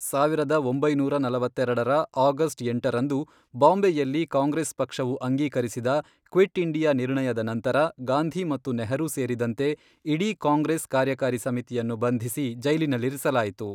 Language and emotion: Kannada, neutral